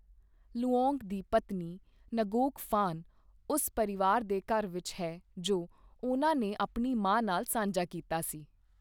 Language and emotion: Punjabi, neutral